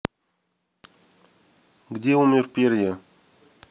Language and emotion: Russian, neutral